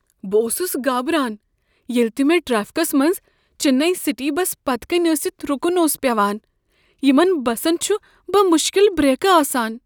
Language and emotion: Kashmiri, fearful